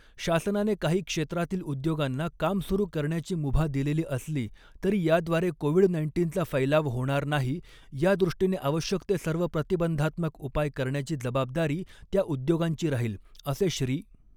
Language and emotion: Marathi, neutral